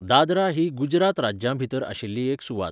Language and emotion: Goan Konkani, neutral